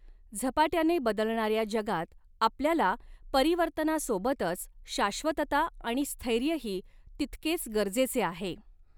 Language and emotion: Marathi, neutral